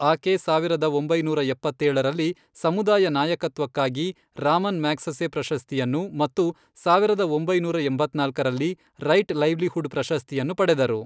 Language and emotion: Kannada, neutral